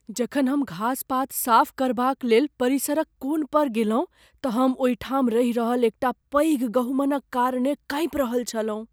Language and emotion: Maithili, fearful